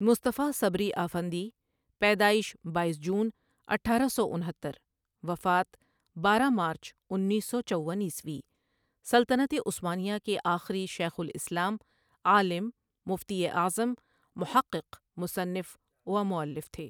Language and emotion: Urdu, neutral